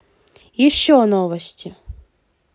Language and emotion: Russian, positive